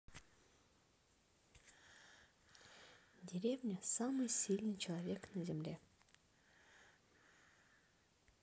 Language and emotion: Russian, neutral